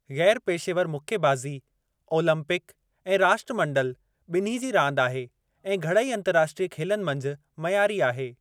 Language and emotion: Sindhi, neutral